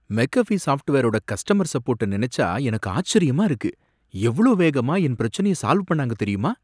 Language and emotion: Tamil, surprised